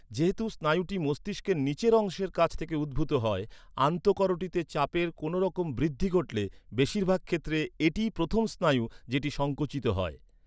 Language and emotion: Bengali, neutral